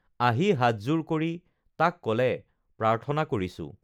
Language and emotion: Assamese, neutral